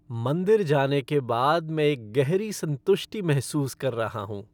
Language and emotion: Hindi, happy